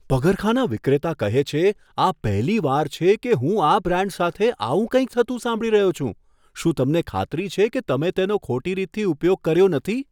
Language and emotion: Gujarati, surprised